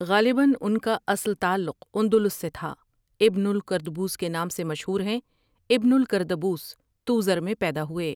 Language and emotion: Urdu, neutral